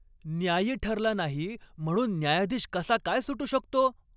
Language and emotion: Marathi, angry